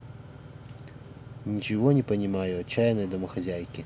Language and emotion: Russian, neutral